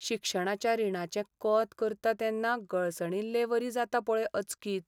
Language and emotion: Goan Konkani, sad